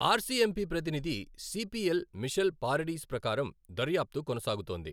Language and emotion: Telugu, neutral